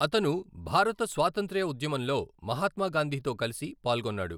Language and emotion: Telugu, neutral